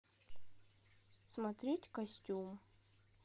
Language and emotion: Russian, neutral